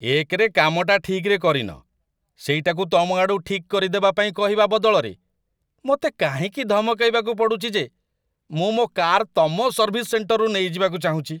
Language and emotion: Odia, disgusted